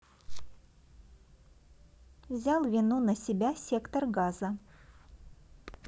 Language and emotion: Russian, neutral